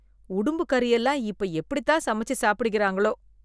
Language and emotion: Tamil, disgusted